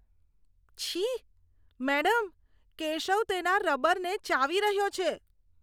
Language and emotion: Gujarati, disgusted